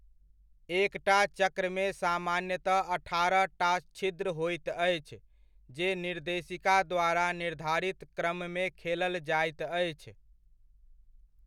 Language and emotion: Maithili, neutral